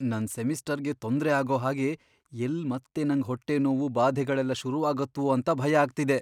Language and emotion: Kannada, fearful